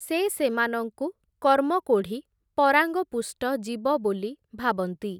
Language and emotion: Odia, neutral